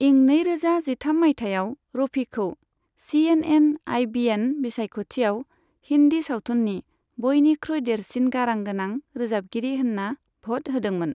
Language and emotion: Bodo, neutral